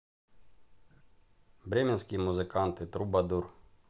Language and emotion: Russian, neutral